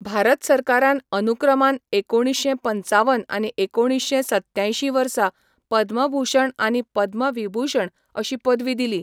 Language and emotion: Goan Konkani, neutral